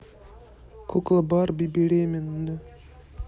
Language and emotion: Russian, neutral